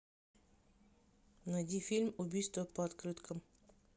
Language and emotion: Russian, neutral